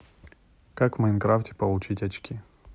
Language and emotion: Russian, neutral